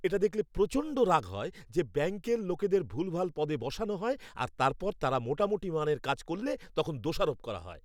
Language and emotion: Bengali, angry